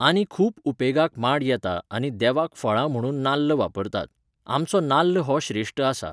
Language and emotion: Goan Konkani, neutral